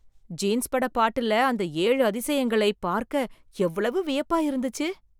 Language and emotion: Tamil, surprised